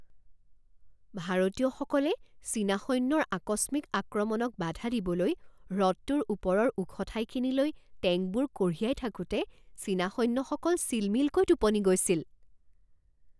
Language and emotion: Assamese, surprised